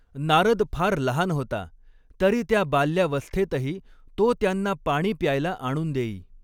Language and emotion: Marathi, neutral